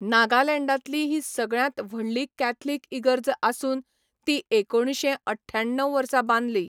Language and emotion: Goan Konkani, neutral